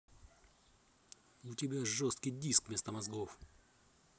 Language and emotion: Russian, angry